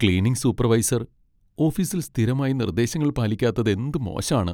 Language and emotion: Malayalam, sad